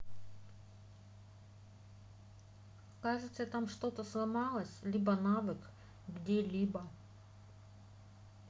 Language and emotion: Russian, neutral